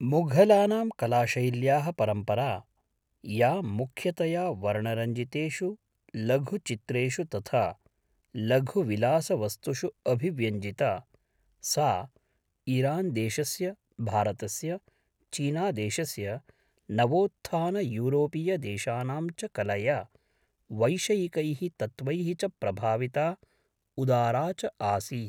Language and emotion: Sanskrit, neutral